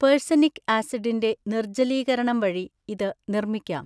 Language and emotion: Malayalam, neutral